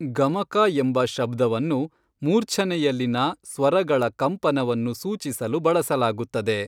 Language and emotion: Kannada, neutral